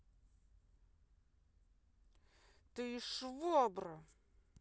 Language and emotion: Russian, angry